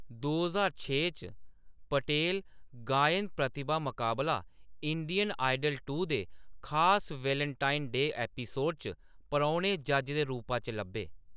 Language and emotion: Dogri, neutral